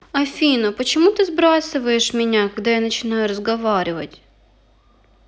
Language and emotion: Russian, sad